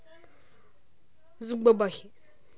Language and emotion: Russian, neutral